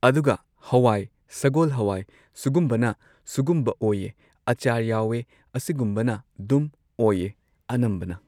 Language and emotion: Manipuri, neutral